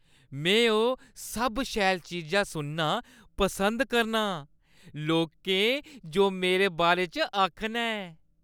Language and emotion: Dogri, happy